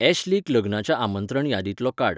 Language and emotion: Goan Konkani, neutral